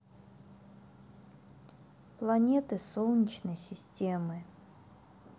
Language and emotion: Russian, sad